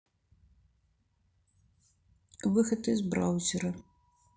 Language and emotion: Russian, neutral